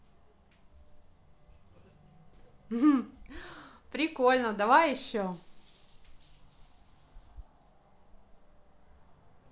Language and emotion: Russian, positive